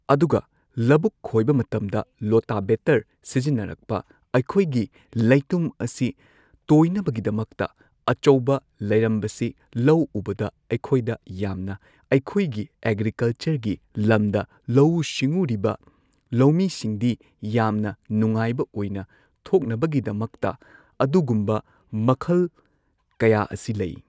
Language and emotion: Manipuri, neutral